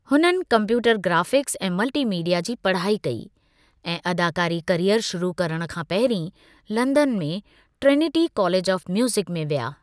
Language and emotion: Sindhi, neutral